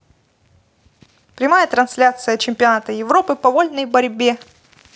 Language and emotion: Russian, positive